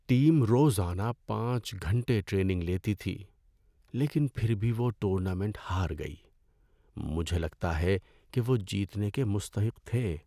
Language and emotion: Urdu, sad